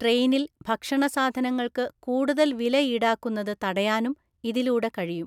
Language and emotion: Malayalam, neutral